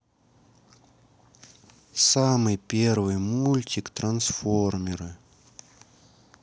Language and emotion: Russian, sad